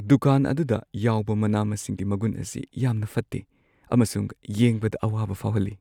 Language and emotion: Manipuri, sad